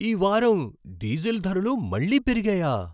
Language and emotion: Telugu, surprised